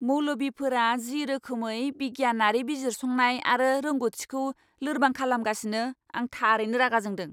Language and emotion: Bodo, angry